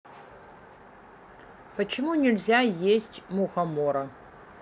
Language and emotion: Russian, neutral